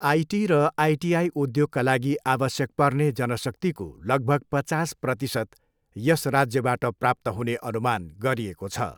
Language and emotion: Nepali, neutral